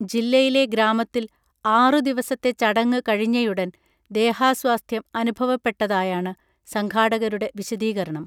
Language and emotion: Malayalam, neutral